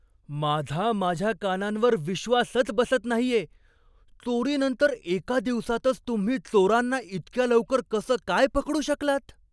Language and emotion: Marathi, surprised